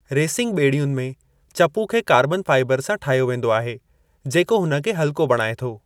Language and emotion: Sindhi, neutral